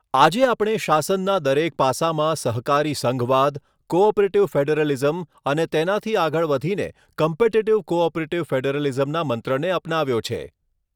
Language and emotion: Gujarati, neutral